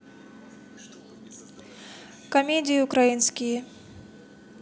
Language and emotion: Russian, neutral